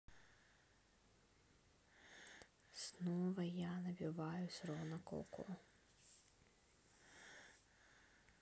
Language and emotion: Russian, neutral